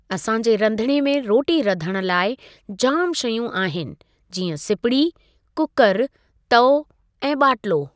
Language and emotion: Sindhi, neutral